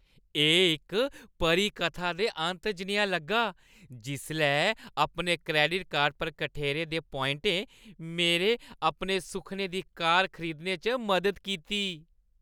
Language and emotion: Dogri, happy